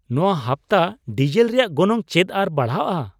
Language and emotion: Santali, surprised